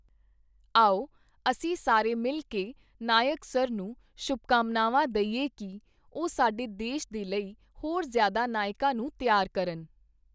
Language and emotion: Punjabi, neutral